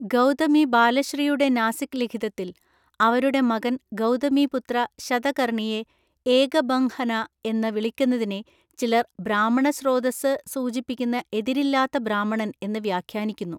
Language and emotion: Malayalam, neutral